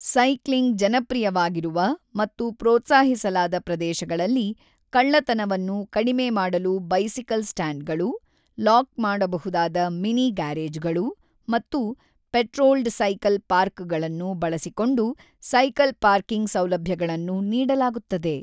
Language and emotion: Kannada, neutral